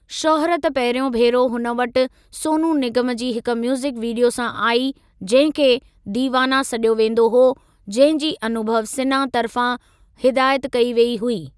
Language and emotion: Sindhi, neutral